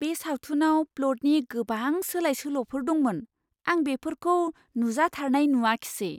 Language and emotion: Bodo, surprised